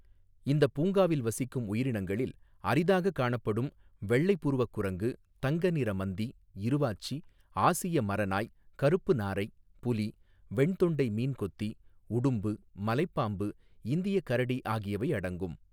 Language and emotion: Tamil, neutral